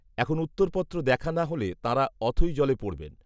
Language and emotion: Bengali, neutral